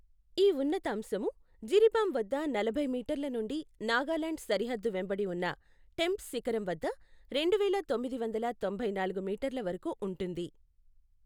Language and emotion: Telugu, neutral